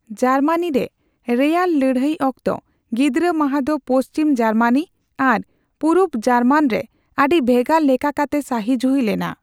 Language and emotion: Santali, neutral